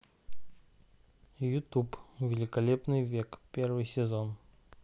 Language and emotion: Russian, neutral